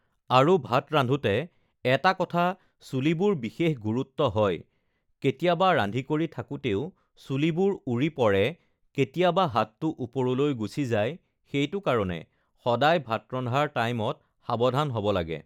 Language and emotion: Assamese, neutral